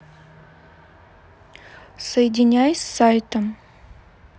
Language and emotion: Russian, neutral